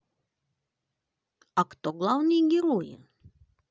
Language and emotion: Russian, positive